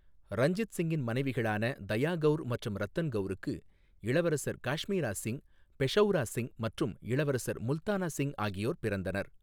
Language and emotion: Tamil, neutral